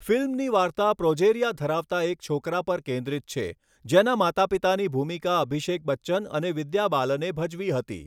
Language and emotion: Gujarati, neutral